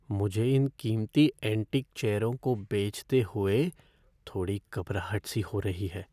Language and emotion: Hindi, fearful